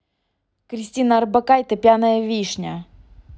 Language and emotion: Russian, angry